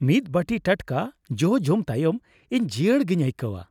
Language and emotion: Santali, happy